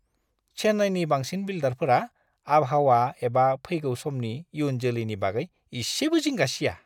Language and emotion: Bodo, disgusted